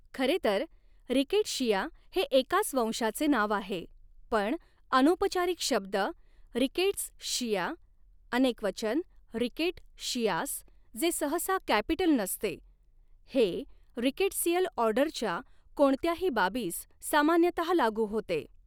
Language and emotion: Marathi, neutral